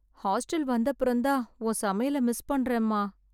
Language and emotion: Tamil, sad